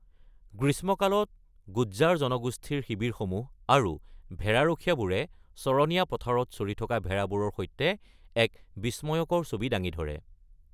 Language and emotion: Assamese, neutral